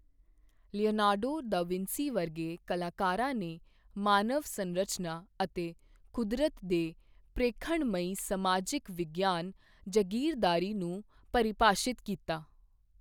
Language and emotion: Punjabi, neutral